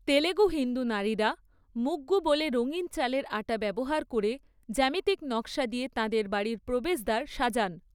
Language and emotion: Bengali, neutral